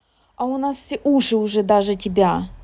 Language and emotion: Russian, angry